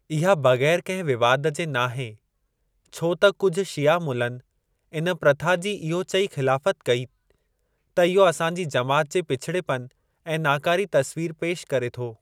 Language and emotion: Sindhi, neutral